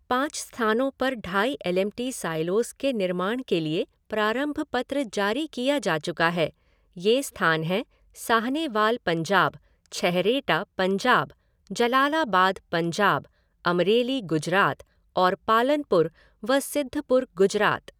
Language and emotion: Hindi, neutral